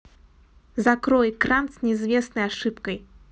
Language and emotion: Russian, neutral